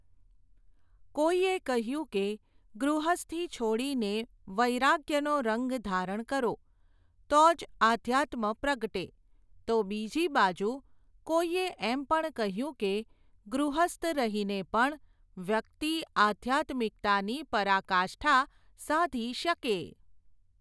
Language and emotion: Gujarati, neutral